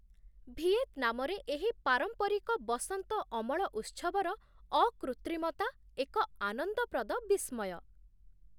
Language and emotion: Odia, surprised